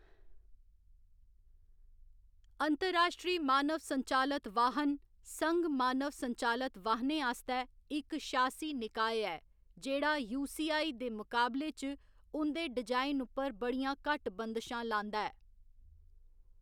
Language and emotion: Dogri, neutral